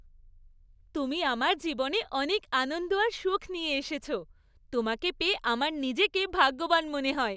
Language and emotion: Bengali, happy